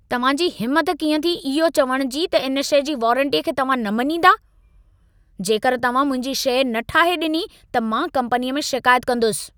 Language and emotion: Sindhi, angry